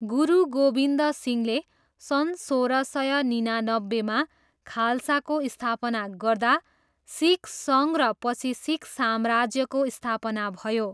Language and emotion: Nepali, neutral